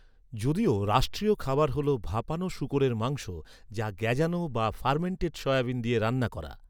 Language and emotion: Bengali, neutral